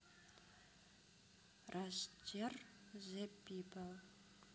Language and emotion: Russian, neutral